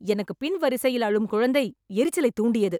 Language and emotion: Tamil, angry